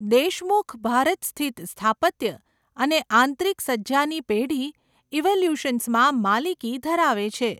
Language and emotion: Gujarati, neutral